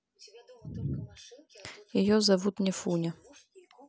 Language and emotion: Russian, neutral